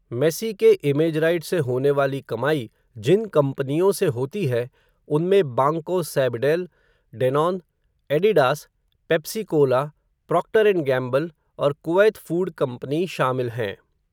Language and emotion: Hindi, neutral